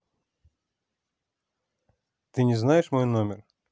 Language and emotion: Russian, neutral